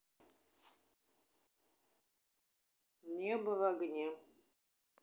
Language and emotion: Russian, neutral